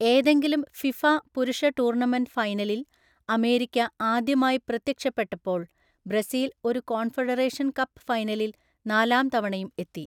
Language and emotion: Malayalam, neutral